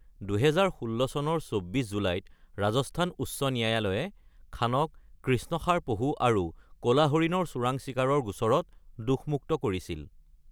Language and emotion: Assamese, neutral